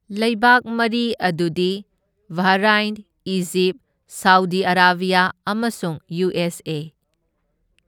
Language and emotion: Manipuri, neutral